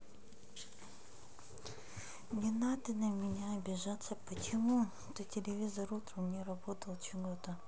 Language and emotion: Russian, sad